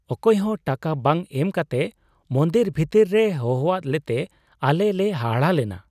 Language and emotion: Santali, surprised